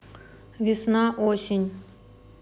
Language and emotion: Russian, neutral